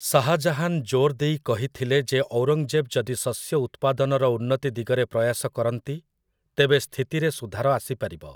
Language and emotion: Odia, neutral